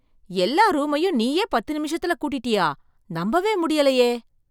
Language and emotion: Tamil, surprised